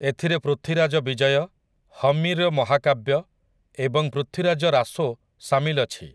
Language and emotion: Odia, neutral